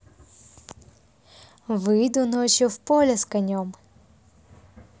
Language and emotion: Russian, neutral